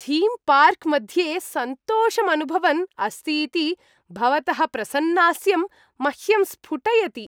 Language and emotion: Sanskrit, happy